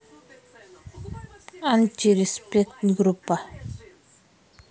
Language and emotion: Russian, neutral